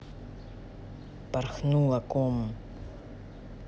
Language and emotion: Russian, neutral